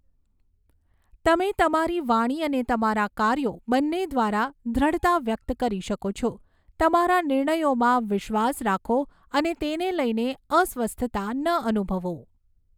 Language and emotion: Gujarati, neutral